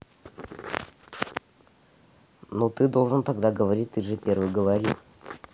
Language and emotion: Russian, neutral